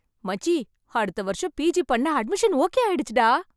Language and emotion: Tamil, happy